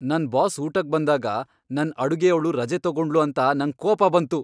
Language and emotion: Kannada, angry